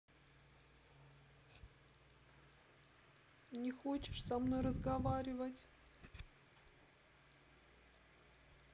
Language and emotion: Russian, sad